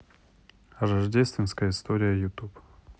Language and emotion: Russian, neutral